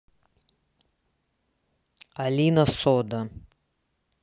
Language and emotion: Russian, neutral